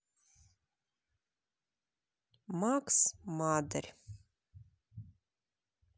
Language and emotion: Russian, neutral